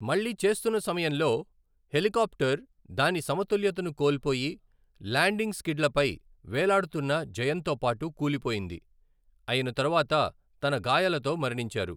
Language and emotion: Telugu, neutral